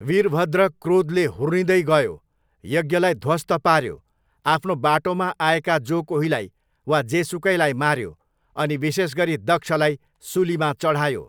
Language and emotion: Nepali, neutral